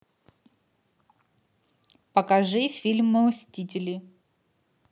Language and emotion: Russian, neutral